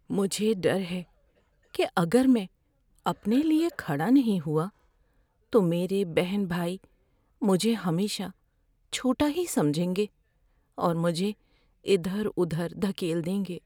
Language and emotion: Urdu, fearful